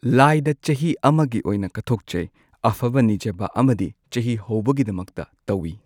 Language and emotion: Manipuri, neutral